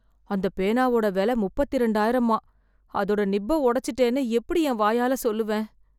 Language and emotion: Tamil, fearful